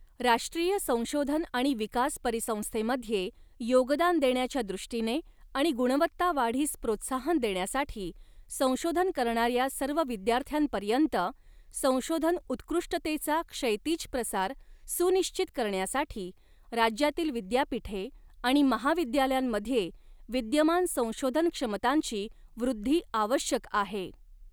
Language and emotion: Marathi, neutral